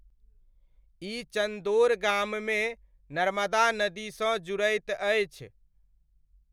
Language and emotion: Maithili, neutral